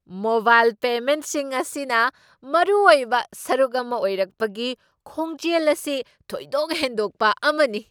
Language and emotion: Manipuri, surprised